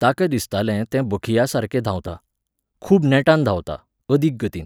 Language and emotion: Goan Konkani, neutral